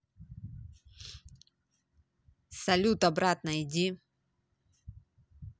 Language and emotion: Russian, neutral